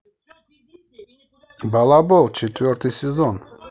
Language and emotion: Russian, positive